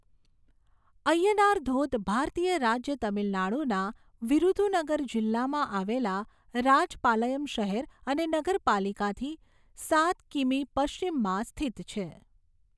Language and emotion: Gujarati, neutral